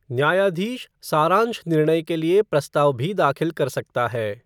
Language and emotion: Hindi, neutral